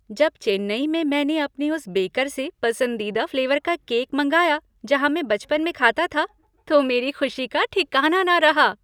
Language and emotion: Hindi, happy